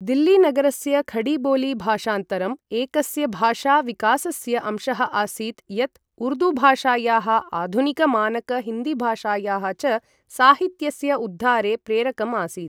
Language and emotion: Sanskrit, neutral